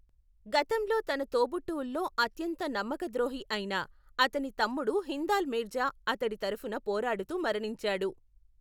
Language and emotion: Telugu, neutral